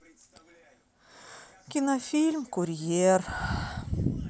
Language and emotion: Russian, sad